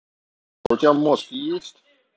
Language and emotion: Russian, angry